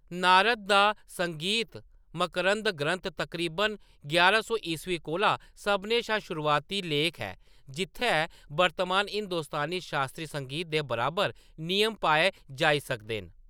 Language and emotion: Dogri, neutral